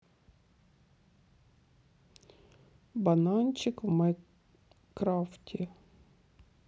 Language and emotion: Russian, neutral